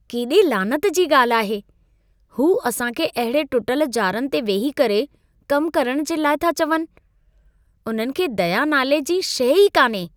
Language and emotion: Sindhi, disgusted